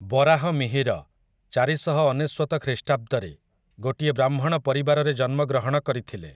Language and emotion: Odia, neutral